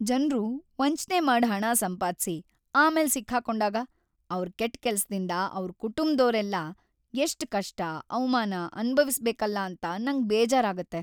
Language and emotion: Kannada, sad